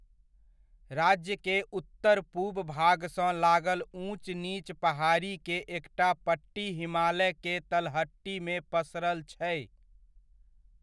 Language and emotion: Maithili, neutral